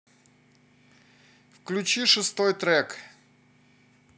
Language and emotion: Russian, neutral